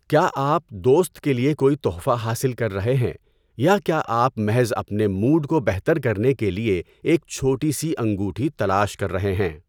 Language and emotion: Urdu, neutral